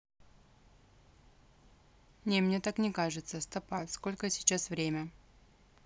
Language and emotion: Russian, neutral